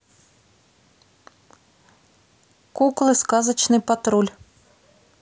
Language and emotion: Russian, neutral